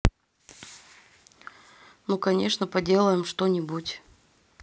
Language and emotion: Russian, neutral